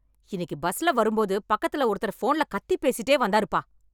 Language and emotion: Tamil, angry